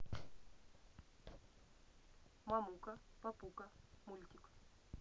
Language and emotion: Russian, neutral